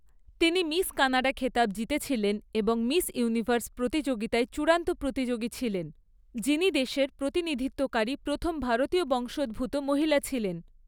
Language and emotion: Bengali, neutral